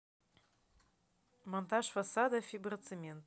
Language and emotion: Russian, neutral